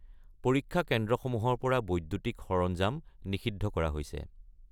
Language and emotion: Assamese, neutral